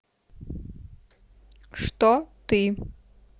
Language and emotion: Russian, neutral